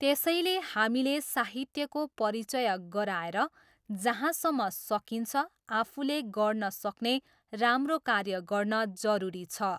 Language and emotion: Nepali, neutral